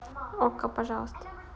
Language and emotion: Russian, neutral